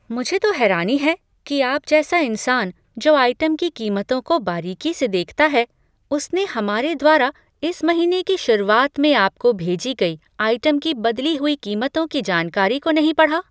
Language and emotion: Hindi, surprised